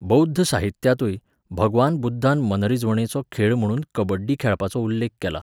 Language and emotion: Goan Konkani, neutral